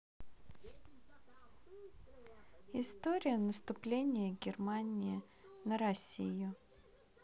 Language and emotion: Russian, neutral